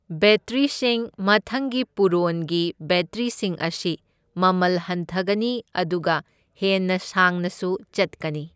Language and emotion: Manipuri, neutral